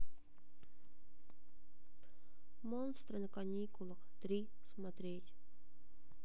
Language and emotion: Russian, sad